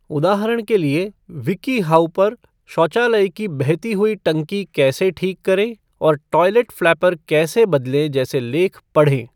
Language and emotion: Hindi, neutral